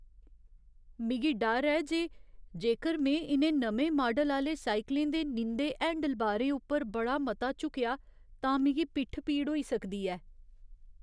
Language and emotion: Dogri, fearful